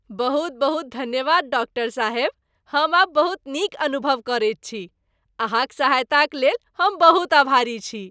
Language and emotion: Maithili, happy